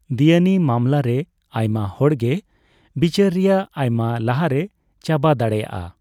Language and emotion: Santali, neutral